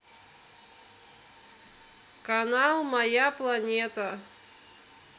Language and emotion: Russian, neutral